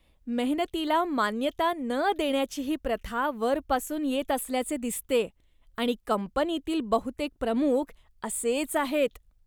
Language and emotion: Marathi, disgusted